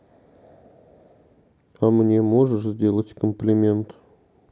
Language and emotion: Russian, sad